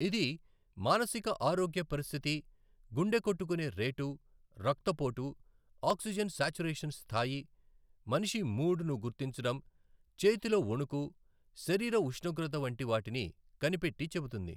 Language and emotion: Telugu, neutral